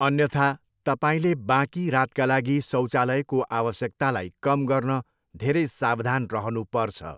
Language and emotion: Nepali, neutral